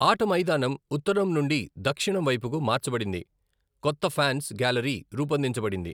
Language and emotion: Telugu, neutral